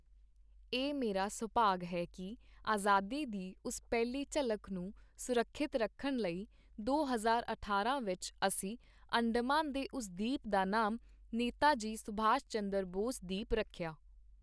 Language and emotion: Punjabi, neutral